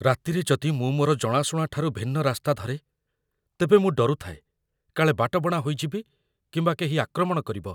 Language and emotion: Odia, fearful